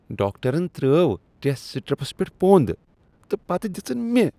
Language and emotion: Kashmiri, disgusted